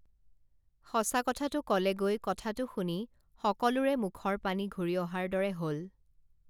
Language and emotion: Assamese, neutral